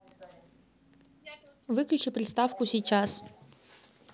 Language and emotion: Russian, neutral